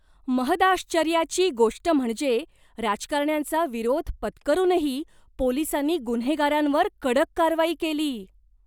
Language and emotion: Marathi, surprised